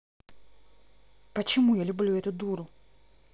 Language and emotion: Russian, angry